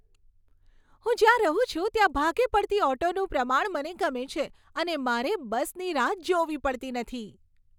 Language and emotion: Gujarati, happy